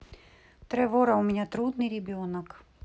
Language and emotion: Russian, neutral